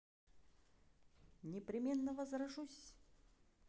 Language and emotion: Russian, neutral